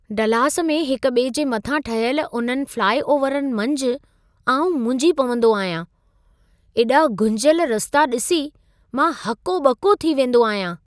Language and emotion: Sindhi, surprised